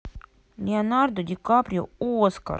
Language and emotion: Russian, neutral